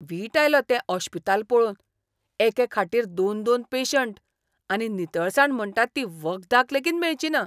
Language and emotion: Goan Konkani, disgusted